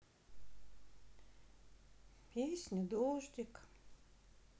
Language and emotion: Russian, sad